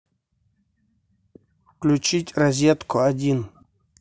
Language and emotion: Russian, neutral